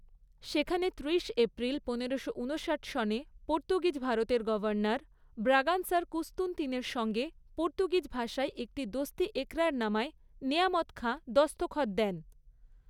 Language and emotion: Bengali, neutral